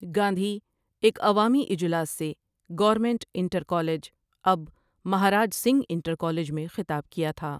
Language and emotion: Urdu, neutral